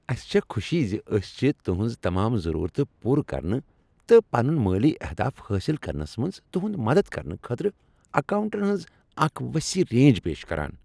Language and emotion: Kashmiri, happy